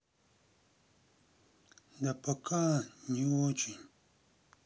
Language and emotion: Russian, sad